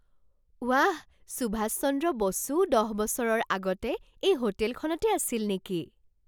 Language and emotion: Assamese, surprised